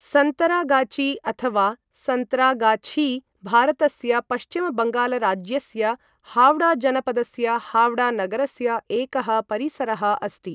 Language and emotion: Sanskrit, neutral